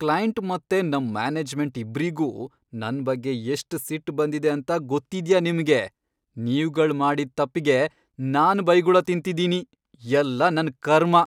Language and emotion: Kannada, angry